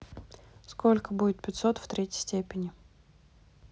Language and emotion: Russian, neutral